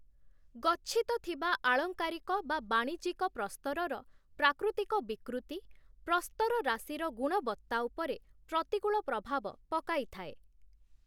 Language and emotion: Odia, neutral